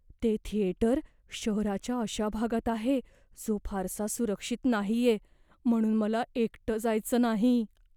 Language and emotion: Marathi, fearful